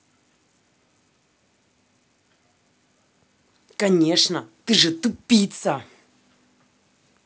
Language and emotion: Russian, angry